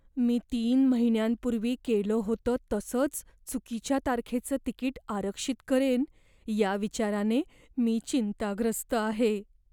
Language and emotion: Marathi, fearful